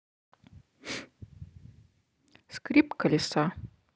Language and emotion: Russian, neutral